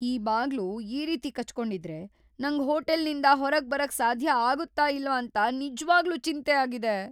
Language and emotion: Kannada, fearful